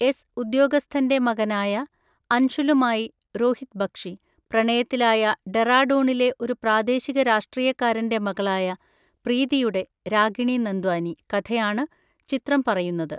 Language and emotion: Malayalam, neutral